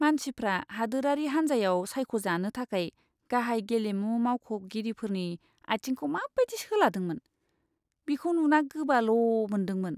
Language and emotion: Bodo, disgusted